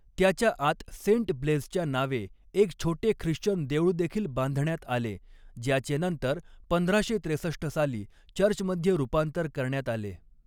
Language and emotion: Marathi, neutral